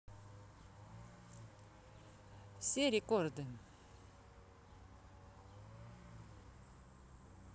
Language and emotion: Russian, neutral